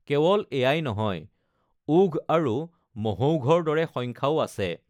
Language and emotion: Assamese, neutral